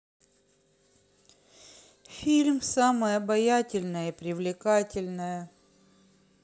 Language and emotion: Russian, sad